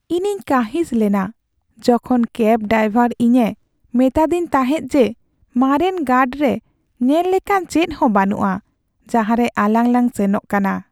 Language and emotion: Santali, sad